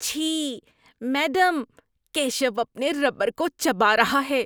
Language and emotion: Urdu, disgusted